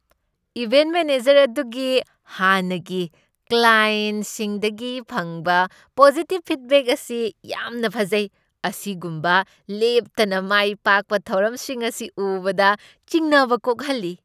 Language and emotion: Manipuri, surprised